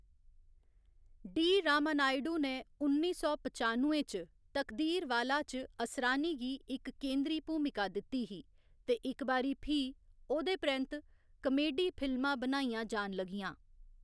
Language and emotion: Dogri, neutral